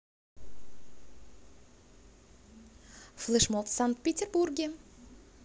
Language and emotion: Russian, positive